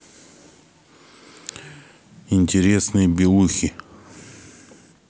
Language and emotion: Russian, neutral